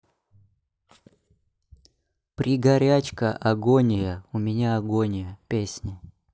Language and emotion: Russian, neutral